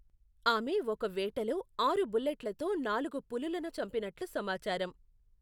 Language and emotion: Telugu, neutral